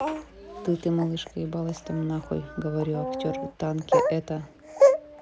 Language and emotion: Russian, neutral